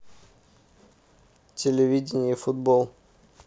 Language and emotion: Russian, neutral